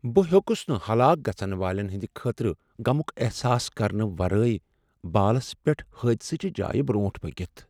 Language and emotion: Kashmiri, sad